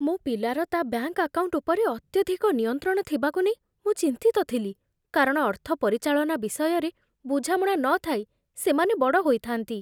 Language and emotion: Odia, fearful